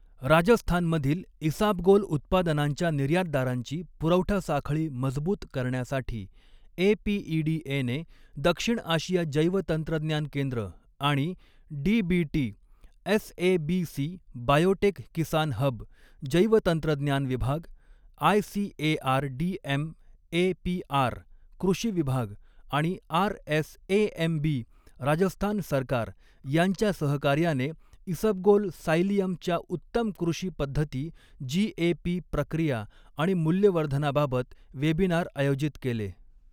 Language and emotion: Marathi, neutral